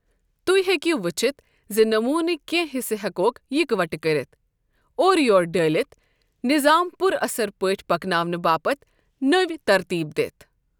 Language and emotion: Kashmiri, neutral